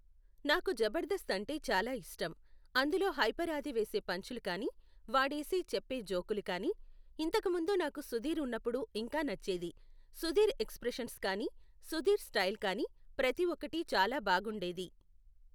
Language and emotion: Telugu, neutral